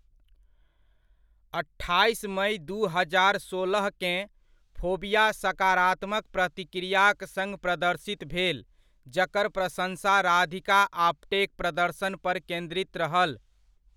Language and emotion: Maithili, neutral